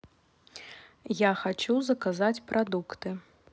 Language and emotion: Russian, neutral